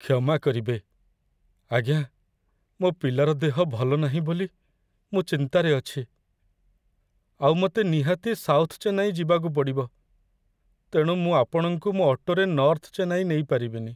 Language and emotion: Odia, sad